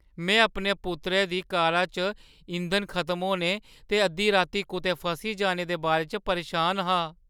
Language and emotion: Dogri, fearful